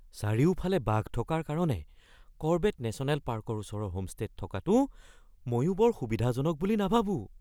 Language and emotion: Assamese, fearful